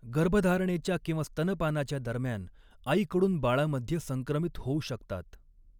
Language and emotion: Marathi, neutral